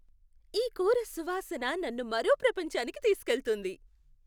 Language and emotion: Telugu, happy